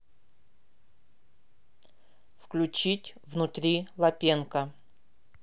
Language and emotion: Russian, neutral